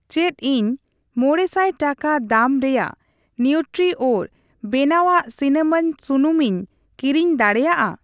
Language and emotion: Santali, neutral